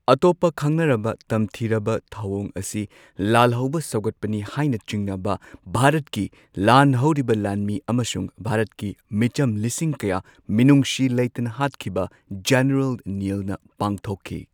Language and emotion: Manipuri, neutral